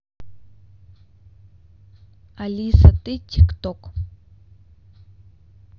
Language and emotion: Russian, neutral